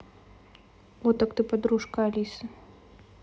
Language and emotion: Russian, neutral